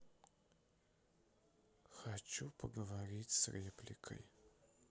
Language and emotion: Russian, sad